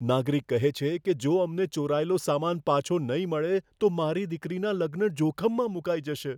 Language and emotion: Gujarati, fearful